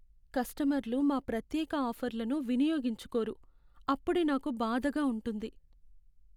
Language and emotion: Telugu, sad